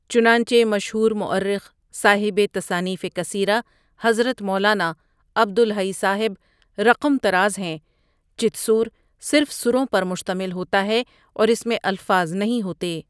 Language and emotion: Urdu, neutral